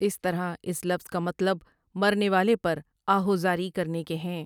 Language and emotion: Urdu, neutral